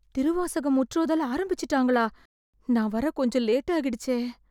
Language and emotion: Tamil, fearful